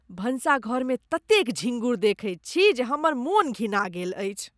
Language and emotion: Maithili, disgusted